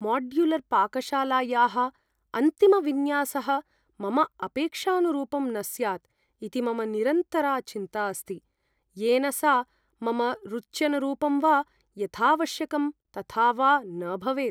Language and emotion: Sanskrit, fearful